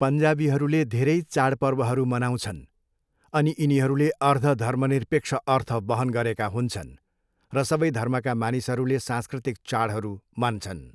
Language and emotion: Nepali, neutral